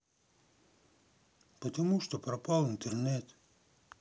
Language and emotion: Russian, sad